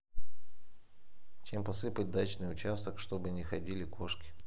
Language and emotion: Russian, neutral